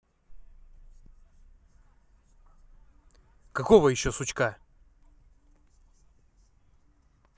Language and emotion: Russian, angry